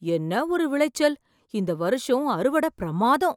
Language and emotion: Tamil, surprised